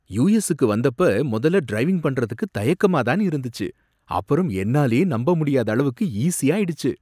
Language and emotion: Tamil, surprised